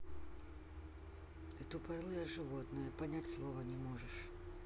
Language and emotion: Russian, neutral